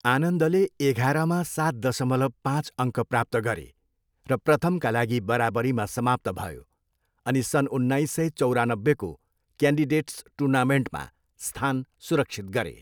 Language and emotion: Nepali, neutral